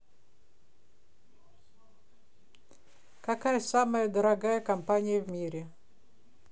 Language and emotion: Russian, neutral